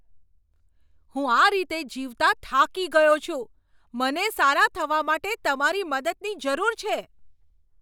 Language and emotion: Gujarati, angry